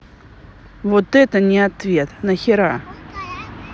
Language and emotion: Russian, angry